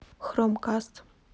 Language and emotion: Russian, neutral